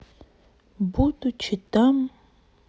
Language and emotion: Russian, sad